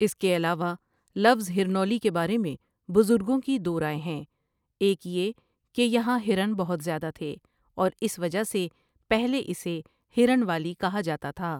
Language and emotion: Urdu, neutral